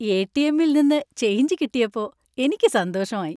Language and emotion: Malayalam, happy